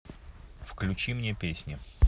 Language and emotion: Russian, neutral